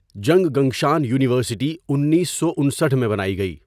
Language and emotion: Urdu, neutral